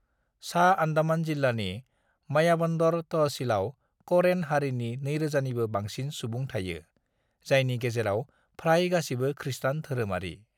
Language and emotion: Bodo, neutral